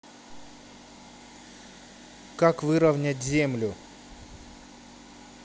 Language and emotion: Russian, neutral